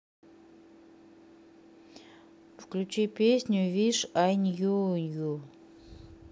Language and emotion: Russian, neutral